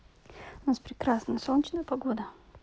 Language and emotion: Russian, neutral